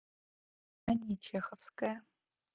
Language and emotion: Russian, neutral